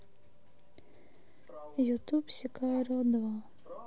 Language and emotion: Russian, sad